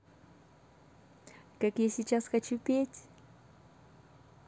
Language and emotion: Russian, positive